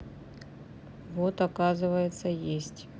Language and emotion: Russian, neutral